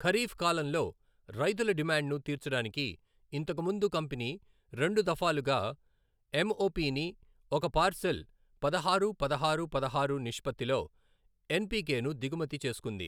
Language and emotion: Telugu, neutral